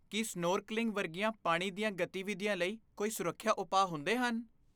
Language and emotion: Punjabi, fearful